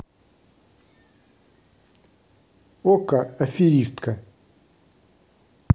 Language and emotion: Russian, neutral